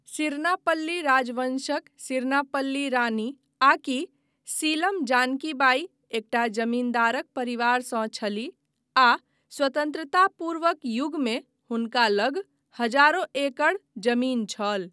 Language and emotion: Maithili, neutral